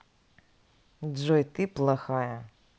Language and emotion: Russian, neutral